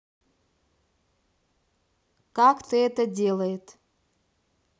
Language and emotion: Russian, neutral